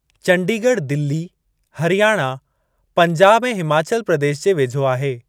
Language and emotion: Sindhi, neutral